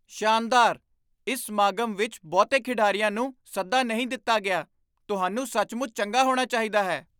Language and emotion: Punjabi, surprised